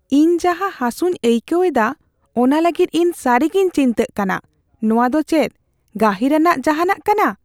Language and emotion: Santali, fearful